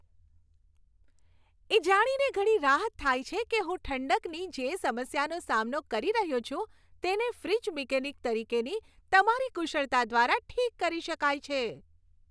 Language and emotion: Gujarati, happy